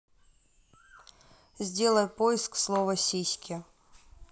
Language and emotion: Russian, neutral